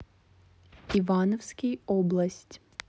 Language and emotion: Russian, neutral